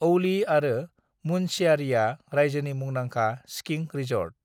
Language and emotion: Bodo, neutral